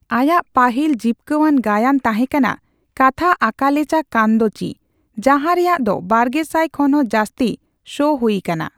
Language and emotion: Santali, neutral